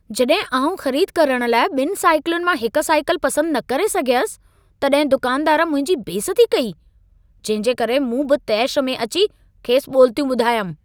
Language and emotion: Sindhi, angry